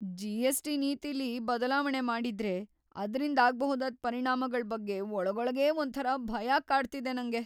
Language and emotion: Kannada, fearful